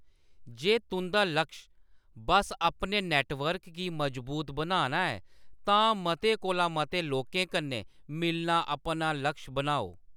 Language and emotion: Dogri, neutral